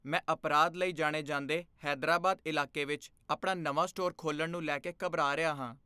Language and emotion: Punjabi, fearful